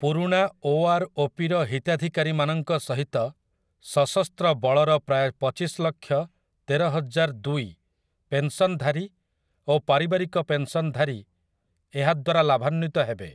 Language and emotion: Odia, neutral